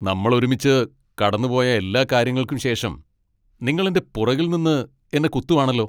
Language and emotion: Malayalam, angry